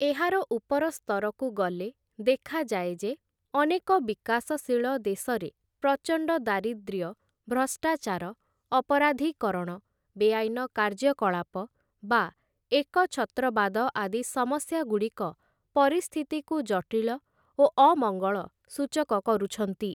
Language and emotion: Odia, neutral